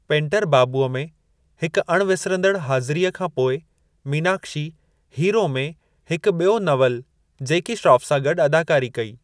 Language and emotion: Sindhi, neutral